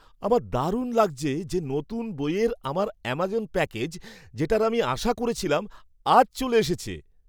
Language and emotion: Bengali, happy